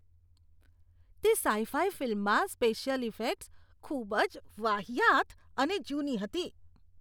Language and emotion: Gujarati, disgusted